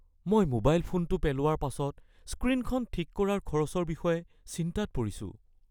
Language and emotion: Assamese, fearful